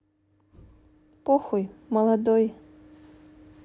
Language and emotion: Russian, neutral